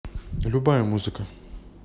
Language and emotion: Russian, neutral